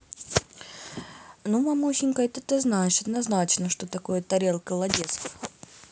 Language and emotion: Russian, neutral